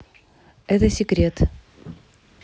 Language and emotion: Russian, neutral